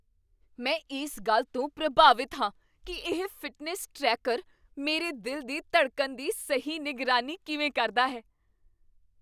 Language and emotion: Punjabi, surprised